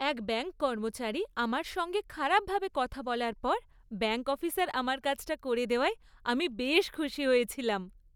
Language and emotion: Bengali, happy